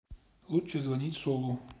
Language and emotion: Russian, neutral